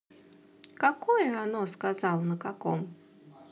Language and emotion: Russian, neutral